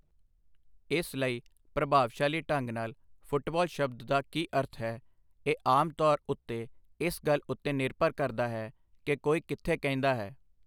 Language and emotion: Punjabi, neutral